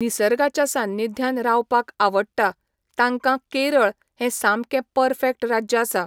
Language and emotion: Goan Konkani, neutral